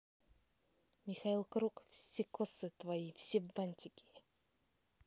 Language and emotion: Russian, neutral